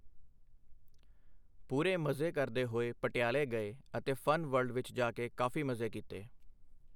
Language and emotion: Punjabi, neutral